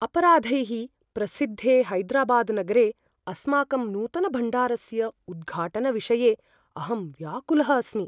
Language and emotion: Sanskrit, fearful